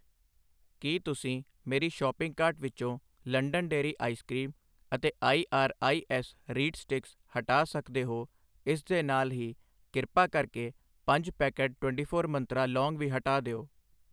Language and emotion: Punjabi, neutral